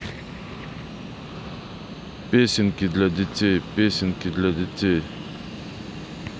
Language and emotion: Russian, neutral